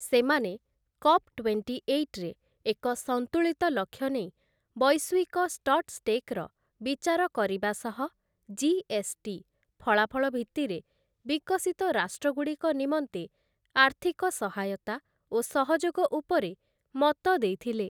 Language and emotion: Odia, neutral